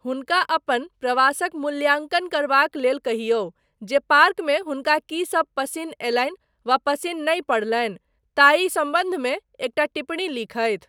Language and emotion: Maithili, neutral